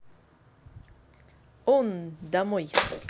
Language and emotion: Russian, positive